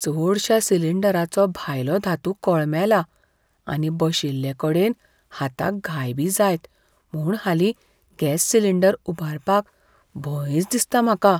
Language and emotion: Goan Konkani, fearful